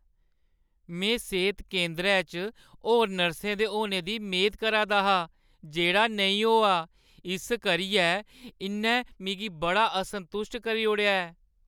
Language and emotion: Dogri, sad